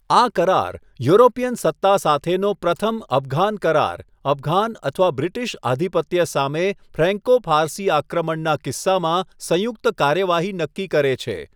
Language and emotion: Gujarati, neutral